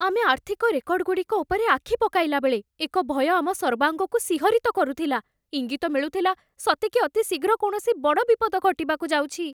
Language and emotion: Odia, fearful